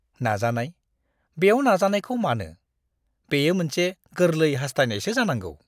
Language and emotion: Bodo, disgusted